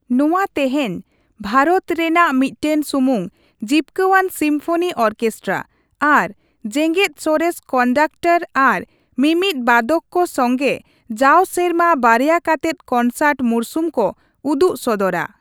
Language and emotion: Santali, neutral